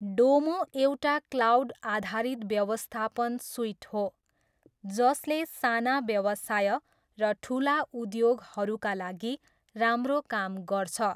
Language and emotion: Nepali, neutral